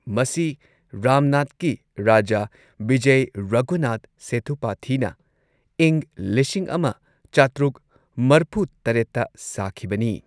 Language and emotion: Manipuri, neutral